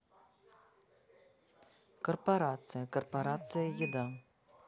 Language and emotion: Russian, neutral